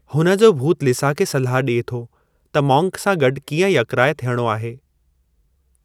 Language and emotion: Sindhi, neutral